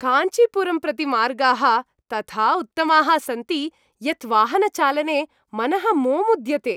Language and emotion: Sanskrit, happy